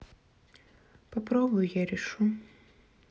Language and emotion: Russian, sad